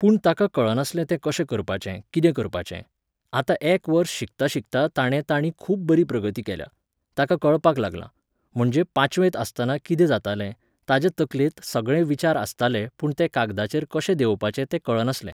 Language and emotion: Goan Konkani, neutral